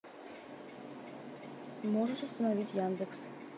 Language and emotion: Russian, neutral